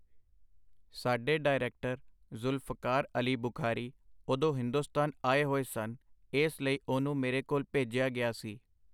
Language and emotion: Punjabi, neutral